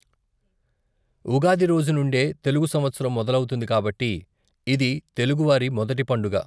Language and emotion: Telugu, neutral